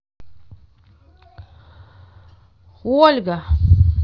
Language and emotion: Russian, neutral